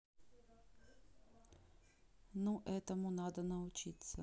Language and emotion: Russian, neutral